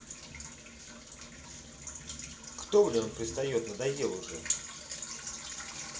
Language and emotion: Russian, angry